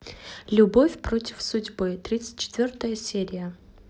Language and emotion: Russian, neutral